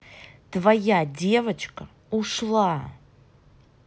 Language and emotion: Russian, angry